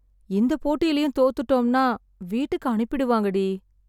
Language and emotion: Tamil, sad